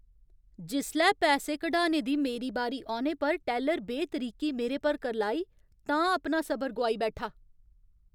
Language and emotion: Dogri, angry